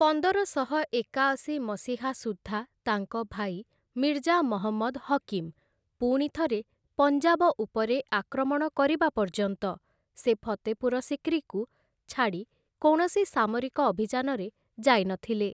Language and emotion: Odia, neutral